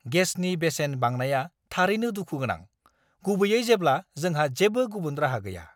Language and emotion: Bodo, angry